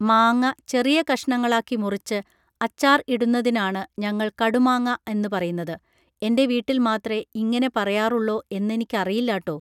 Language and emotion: Malayalam, neutral